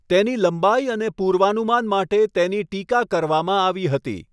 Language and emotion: Gujarati, neutral